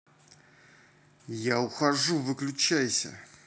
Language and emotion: Russian, angry